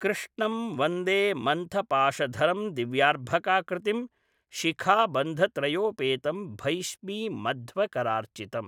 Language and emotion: Sanskrit, neutral